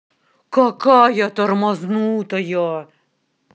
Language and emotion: Russian, angry